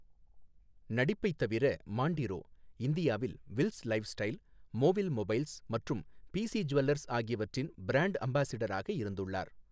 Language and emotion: Tamil, neutral